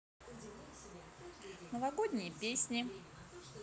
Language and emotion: Russian, positive